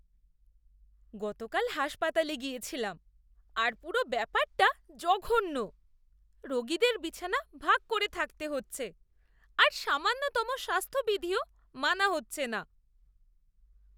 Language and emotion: Bengali, disgusted